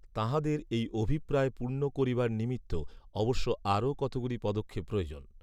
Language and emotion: Bengali, neutral